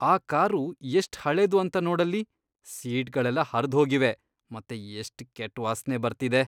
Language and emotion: Kannada, disgusted